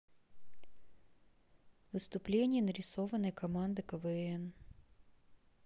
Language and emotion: Russian, neutral